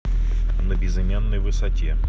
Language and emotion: Russian, neutral